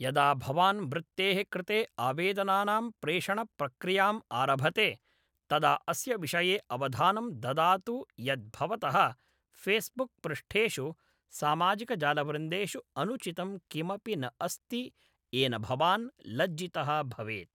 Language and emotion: Sanskrit, neutral